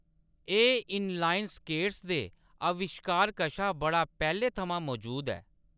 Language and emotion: Dogri, neutral